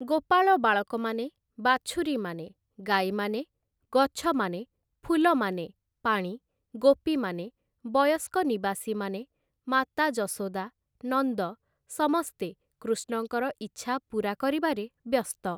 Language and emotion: Odia, neutral